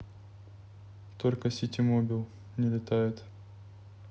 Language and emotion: Russian, neutral